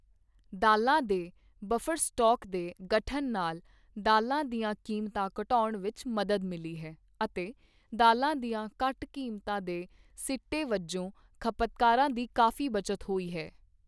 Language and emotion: Punjabi, neutral